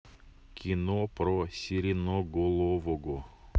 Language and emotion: Russian, neutral